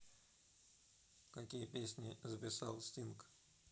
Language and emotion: Russian, neutral